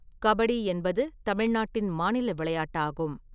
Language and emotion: Tamil, neutral